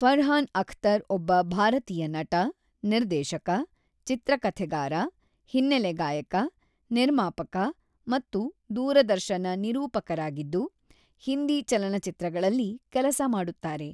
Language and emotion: Kannada, neutral